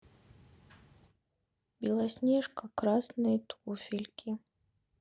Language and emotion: Russian, sad